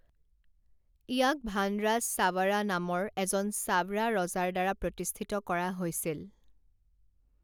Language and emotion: Assamese, neutral